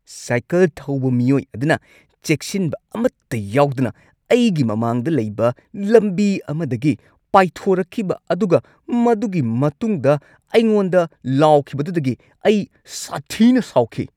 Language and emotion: Manipuri, angry